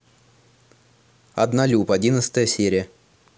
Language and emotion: Russian, neutral